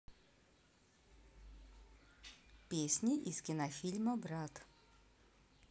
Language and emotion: Russian, neutral